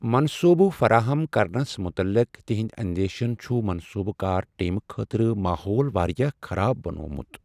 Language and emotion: Kashmiri, sad